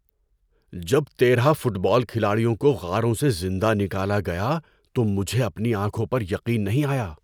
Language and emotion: Urdu, surprised